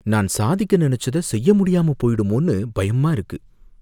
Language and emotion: Tamil, fearful